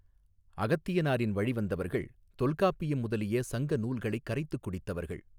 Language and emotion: Tamil, neutral